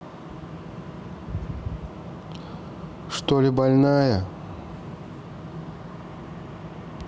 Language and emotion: Russian, neutral